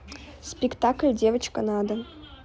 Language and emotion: Russian, neutral